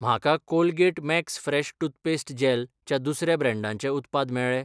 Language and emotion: Goan Konkani, neutral